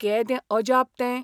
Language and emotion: Goan Konkani, surprised